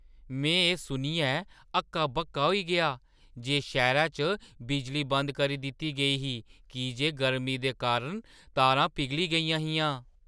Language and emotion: Dogri, surprised